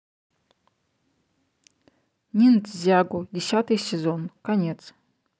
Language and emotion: Russian, neutral